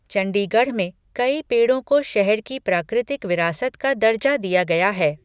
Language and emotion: Hindi, neutral